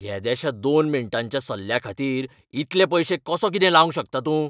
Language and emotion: Goan Konkani, angry